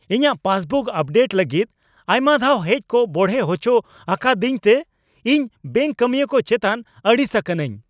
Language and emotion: Santali, angry